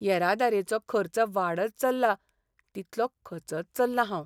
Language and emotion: Goan Konkani, sad